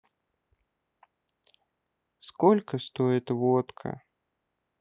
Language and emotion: Russian, sad